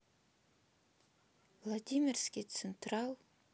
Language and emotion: Russian, sad